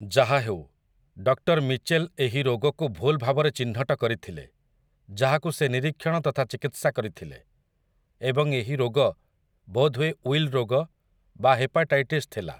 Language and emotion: Odia, neutral